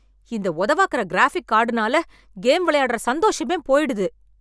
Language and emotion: Tamil, angry